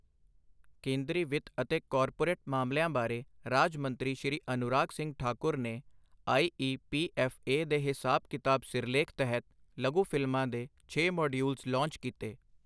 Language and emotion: Punjabi, neutral